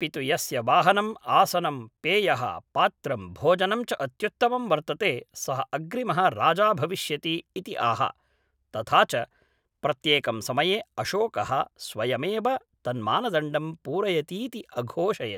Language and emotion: Sanskrit, neutral